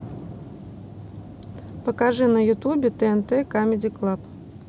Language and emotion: Russian, neutral